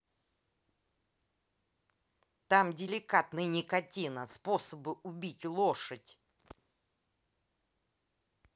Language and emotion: Russian, angry